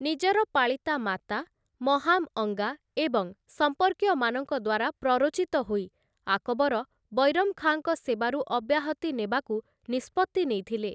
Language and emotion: Odia, neutral